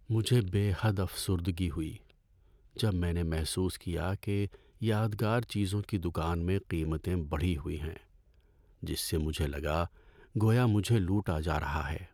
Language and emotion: Urdu, sad